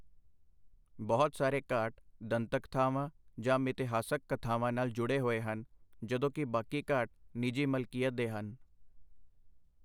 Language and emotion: Punjabi, neutral